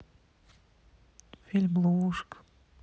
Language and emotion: Russian, sad